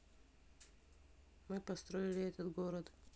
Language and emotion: Russian, neutral